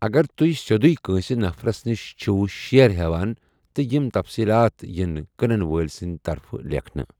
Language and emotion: Kashmiri, neutral